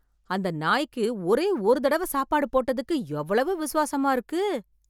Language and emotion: Tamil, surprised